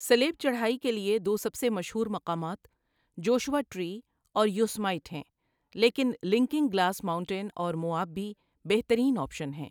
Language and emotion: Urdu, neutral